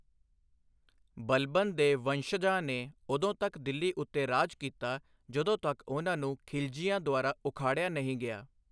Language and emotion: Punjabi, neutral